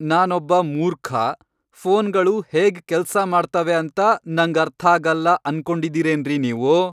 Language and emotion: Kannada, angry